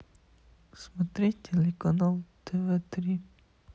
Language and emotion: Russian, sad